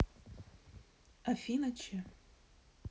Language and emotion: Russian, neutral